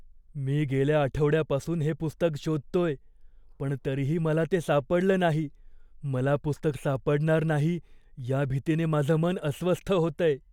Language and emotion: Marathi, fearful